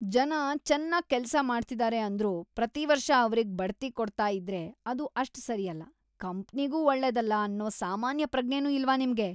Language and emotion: Kannada, disgusted